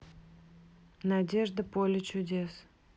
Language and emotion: Russian, neutral